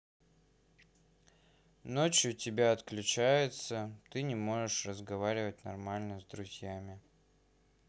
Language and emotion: Russian, sad